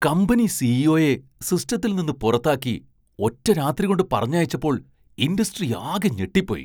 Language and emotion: Malayalam, surprised